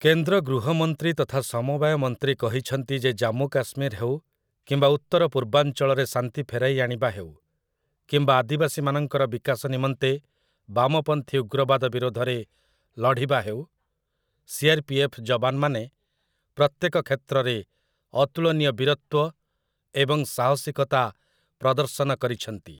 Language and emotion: Odia, neutral